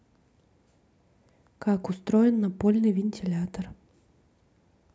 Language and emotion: Russian, neutral